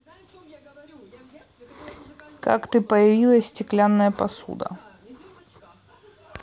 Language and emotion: Russian, neutral